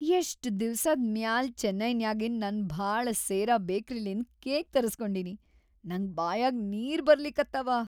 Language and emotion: Kannada, happy